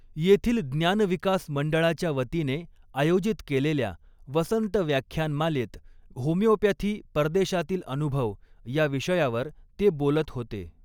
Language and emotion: Marathi, neutral